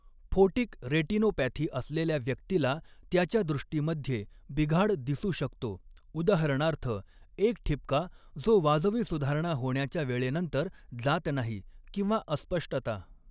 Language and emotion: Marathi, neutral